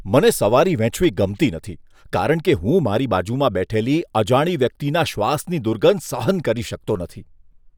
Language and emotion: Gujarati, disgusted